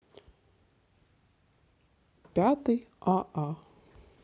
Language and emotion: Russian, neutral